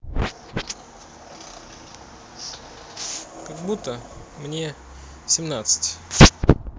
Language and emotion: Russian, neutral